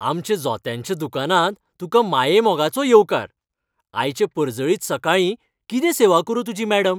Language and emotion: Goan Konkani, happy